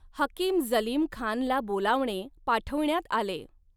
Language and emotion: Marathi, neutral